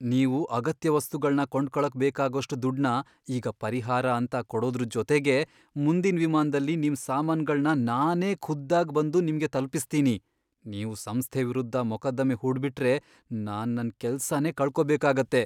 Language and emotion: Kannada, fearful